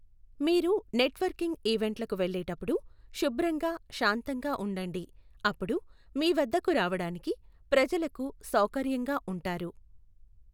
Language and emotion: Telugu, neutral